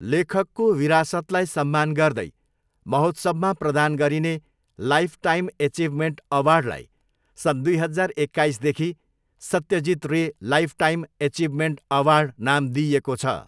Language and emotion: Nepali, neutral